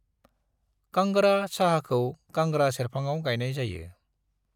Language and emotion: Bodo, neutral